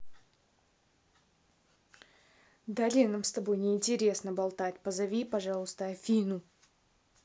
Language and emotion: Russian, angry